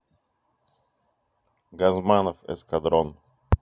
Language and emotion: Russian, neutral